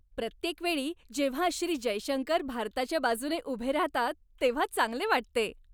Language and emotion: Marathi, happy